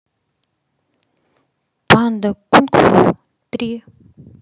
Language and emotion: Russian, positive